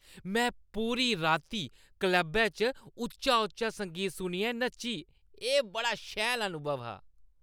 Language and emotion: Dogri, happy